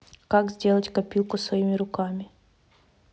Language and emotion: Russian, neutral